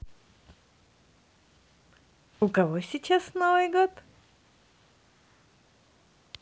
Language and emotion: Russian, positive